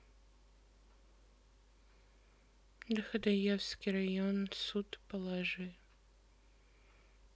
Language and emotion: Russian, sad